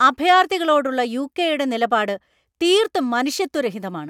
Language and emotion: Malayalam, angry